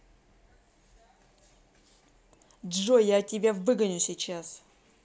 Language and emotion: Russian, angry